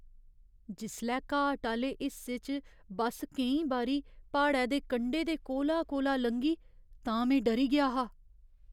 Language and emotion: Dogri, fearful